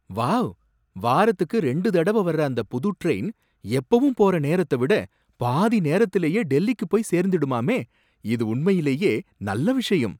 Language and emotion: Tamil, surprised